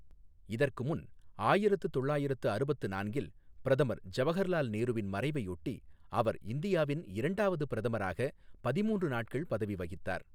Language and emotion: Tamil, neutral